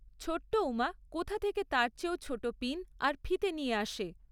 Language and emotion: Bengali, neutral